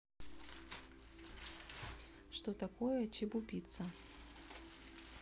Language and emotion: Russian, neutral